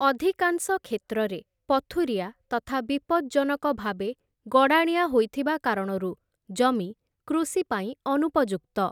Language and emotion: Odia, neutral